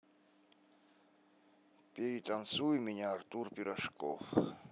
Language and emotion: Russian, neutral